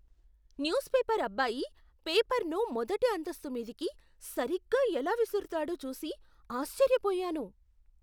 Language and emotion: Telugu, surprised